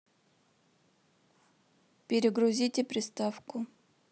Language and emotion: Russian, neutral